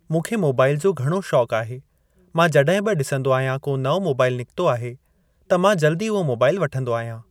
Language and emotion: Sindhi, neutral